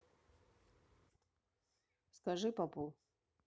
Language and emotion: Russian, neutral